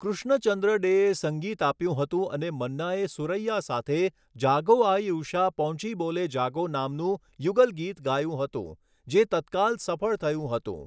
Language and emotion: Gujarati, neutral